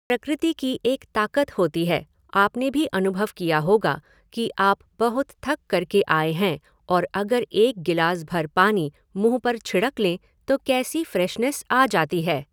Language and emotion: Hindi, neutral